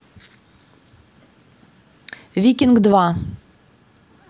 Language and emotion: Russian, neutral